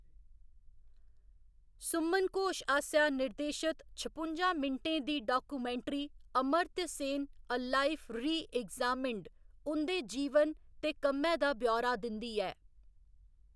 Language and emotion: Dogri, neutral